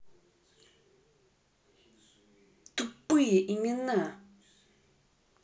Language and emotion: Russian, angry